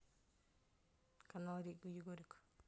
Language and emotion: Russian, neutral